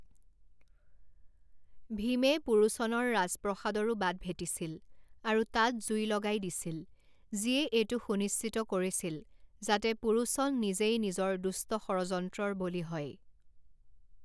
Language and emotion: Assamese, neutral